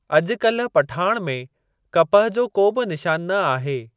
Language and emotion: Sindhi, neutral